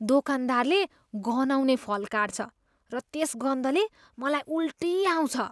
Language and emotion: Nepali, disgusted